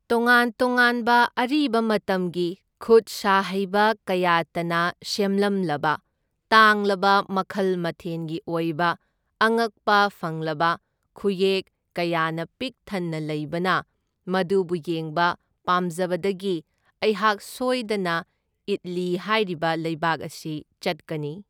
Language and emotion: Manipuri, neutral